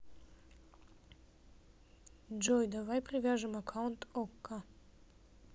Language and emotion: Russian, neutral